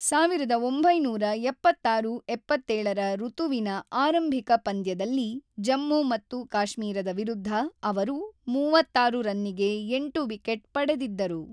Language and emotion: Kannada, neutral